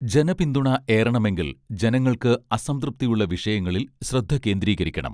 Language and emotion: Malayalam, neutral